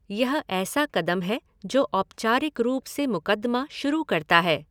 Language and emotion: Hindi, neutral